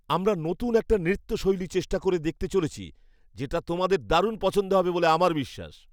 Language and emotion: Bengali, happy